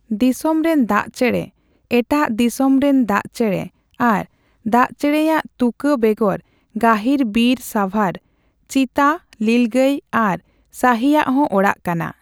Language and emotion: Santali, neutral